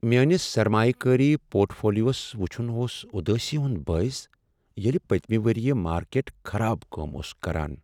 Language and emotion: Kashmiri, sad